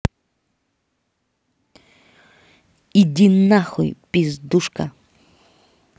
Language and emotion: Russian, angry